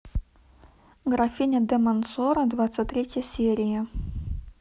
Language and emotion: Russian, neutral